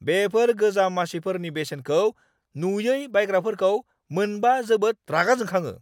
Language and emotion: Bodo, angry